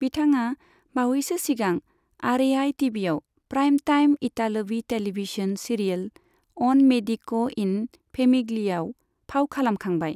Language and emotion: Bodo, neutral